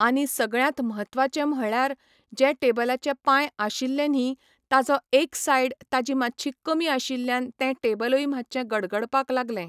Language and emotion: Goan Konkani, neutral